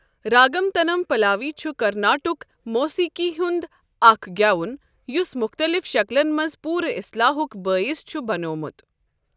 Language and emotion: Kashmiri, neutral